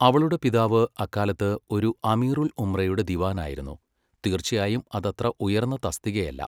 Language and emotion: Malayalam, neutral